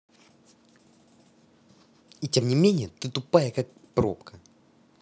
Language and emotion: Russian, angry